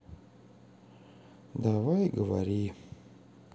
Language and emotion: Russian, sad